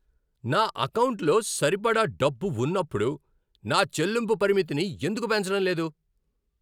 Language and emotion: Telugu, angry